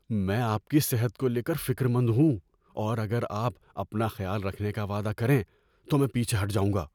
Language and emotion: Urdu, fearful